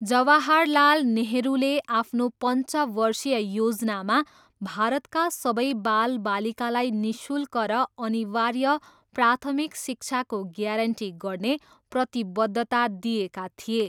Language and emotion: Nepali, neutral